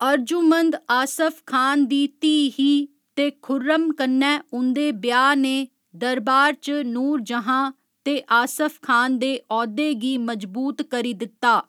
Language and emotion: Dogri, neutral